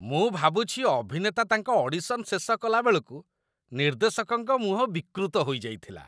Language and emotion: Odia, disgusted